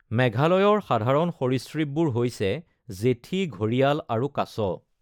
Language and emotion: Assamese, neutral